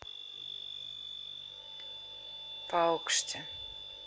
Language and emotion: Russian, neutral